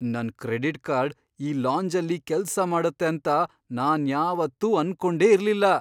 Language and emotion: Kannada, surprised